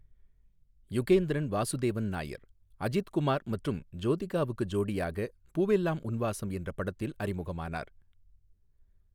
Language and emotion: Tamil, neutral